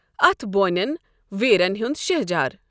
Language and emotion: Kashmiri, neutral